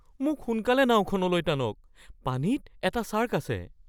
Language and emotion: Assamese, fearful